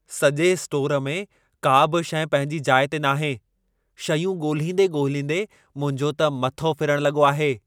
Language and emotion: Sindhi, angry